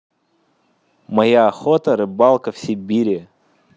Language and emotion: Russian, neutral